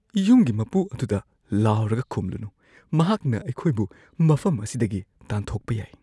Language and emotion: Manipuri, fearful